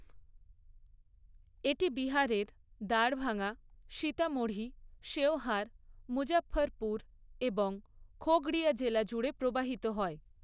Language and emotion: Bengali, neutral